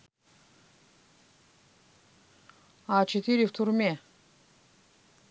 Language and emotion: Russian, neutral